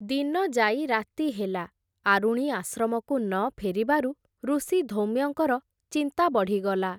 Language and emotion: Odia, neutral